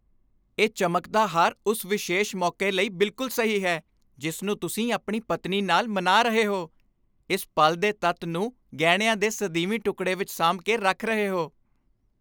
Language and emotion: Punjabi, happy